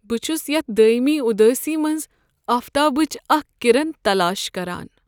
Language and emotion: Kashmiri, sad